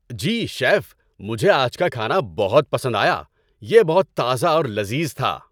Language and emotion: Urdu, happy